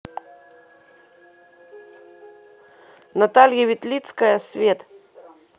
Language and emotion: Russian, neutral